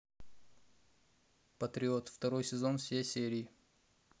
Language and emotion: Russian, neutral